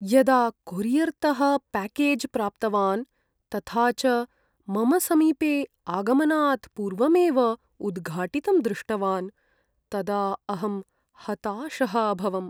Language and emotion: Sanskrit, sad